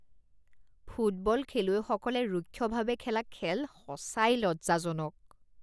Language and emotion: Assamese, disgusted